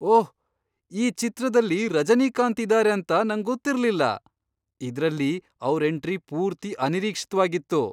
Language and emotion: Kannada, surprised